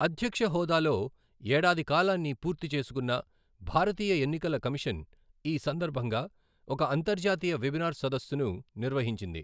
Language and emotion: Telugu, neutral